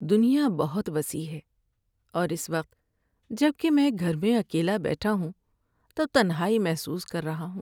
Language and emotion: Urdu, sad